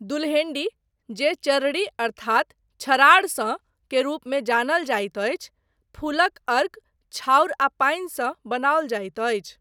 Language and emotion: Maithili, neutral